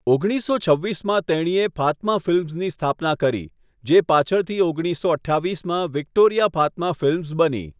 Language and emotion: Gujarati, neutral